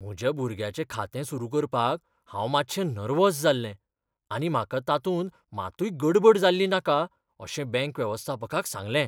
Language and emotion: Goan Konkani, fearful